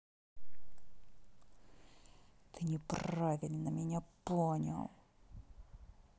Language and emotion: Russian, angry